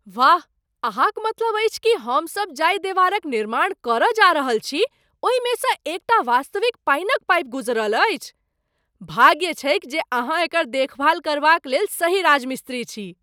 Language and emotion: Maithili, surprised